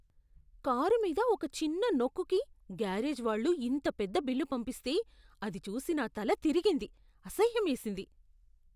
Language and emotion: Telugu, disgusted